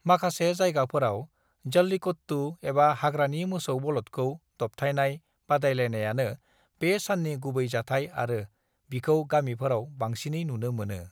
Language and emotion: Bodo, neutral